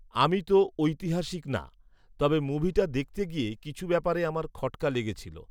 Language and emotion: Bengali, neutral